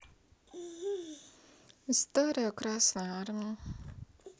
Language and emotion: Russian, sad